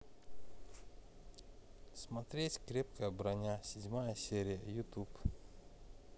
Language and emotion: Russian, neutral